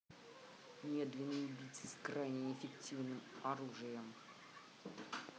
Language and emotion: Russian, angry